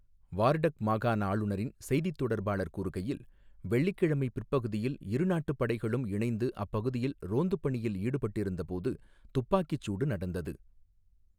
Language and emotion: Tamil, neutral